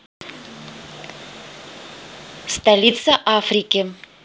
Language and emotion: Russian, neutral